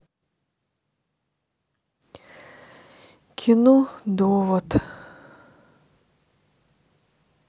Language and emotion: Russian, sad